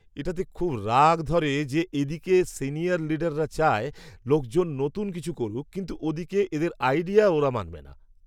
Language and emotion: Bengali, angry